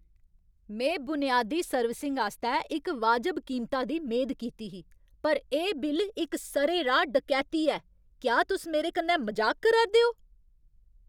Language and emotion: Dogri, angry